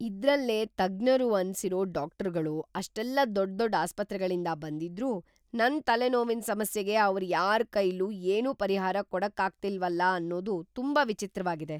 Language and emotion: Kannada, surprised